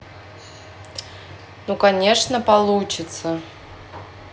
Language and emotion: Russian, neutral